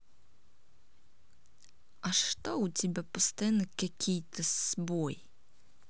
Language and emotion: Russian, angry